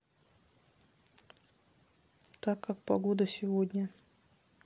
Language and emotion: Russian, neutral